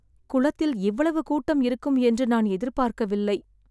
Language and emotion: Tamil, sad